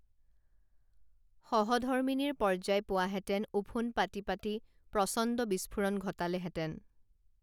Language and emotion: Assamese, neutral